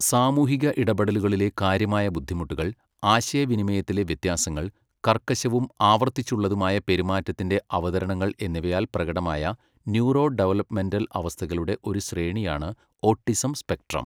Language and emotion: Malayalam, neutral